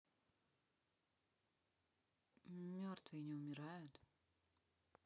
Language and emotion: Russian, neutral